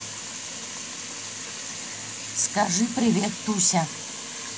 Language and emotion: Russian, neutral